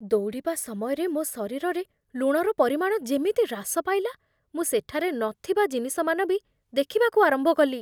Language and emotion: Odia, fearful